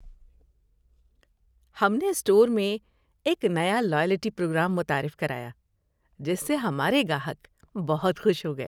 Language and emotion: Urdu, happy